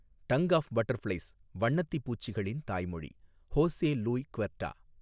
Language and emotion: Tamil, neutral